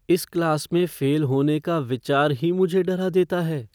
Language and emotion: Hindi, fearful